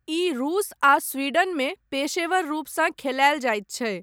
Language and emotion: Maithili, neutral